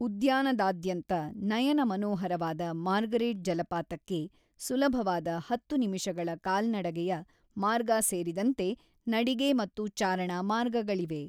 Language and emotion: Kannada, neutral